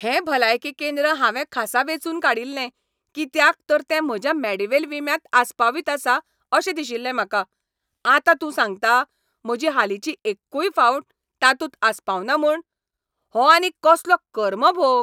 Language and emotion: Goan Konkani, angry